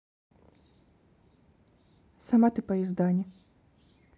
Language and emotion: Russian, neutral